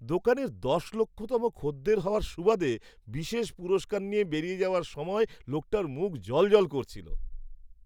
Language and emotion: Bengali, happy